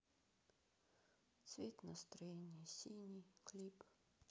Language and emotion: Russian, sad